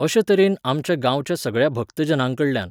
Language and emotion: Goan Konkani, neutral